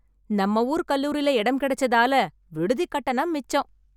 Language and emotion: Tamil, happy